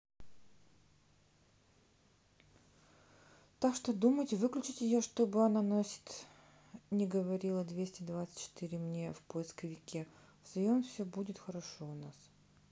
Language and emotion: Russian, neutral